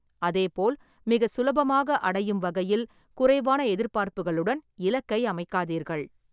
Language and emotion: Tamil, neutral